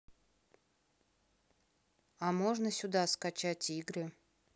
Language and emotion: Russian, neutral